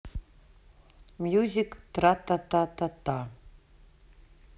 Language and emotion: Russian, neutral